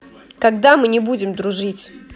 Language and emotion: Russian, angry